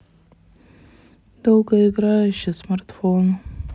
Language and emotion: Russian, sad